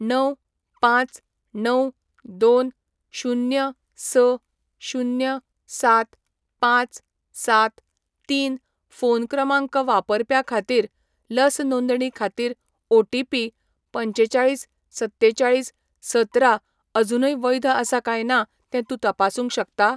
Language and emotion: Goan Konkani, neutral